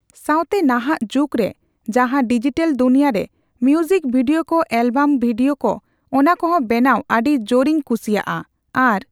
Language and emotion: Santali, neutral